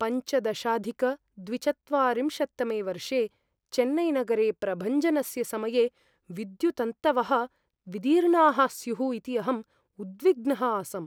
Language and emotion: Sanskrit, fearful